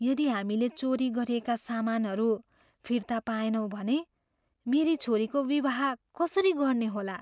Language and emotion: Nepali, fearful